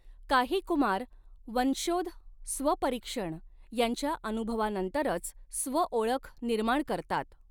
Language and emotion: Marathi, neutral